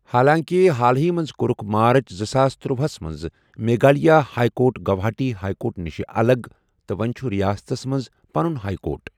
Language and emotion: Kashmiri, neutral